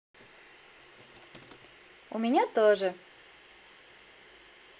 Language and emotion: Russian, positive